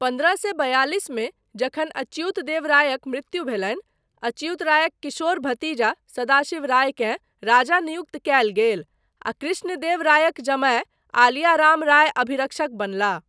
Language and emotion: Maithili, neutral